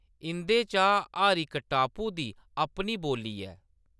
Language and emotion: Dogri, neutral